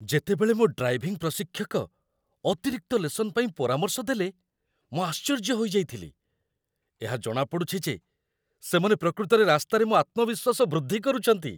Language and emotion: Odia, surprised